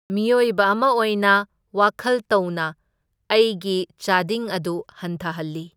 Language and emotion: Manipuri, neutral